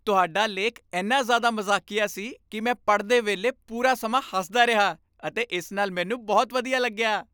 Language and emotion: Punjabi, happy